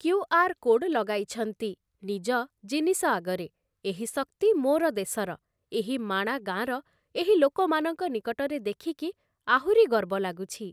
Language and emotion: Odia, neutral